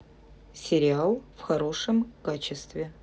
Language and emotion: Russian, neutral